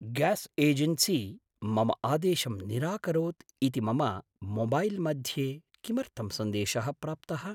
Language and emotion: Sanskrit, surprised